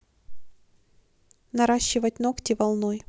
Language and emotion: Russian, neutral